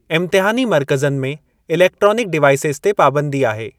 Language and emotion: Sindhi, neutral